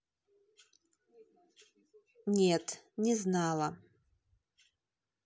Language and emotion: Russian, neutral